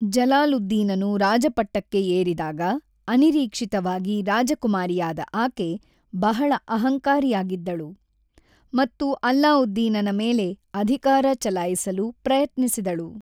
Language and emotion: Kannada, neutral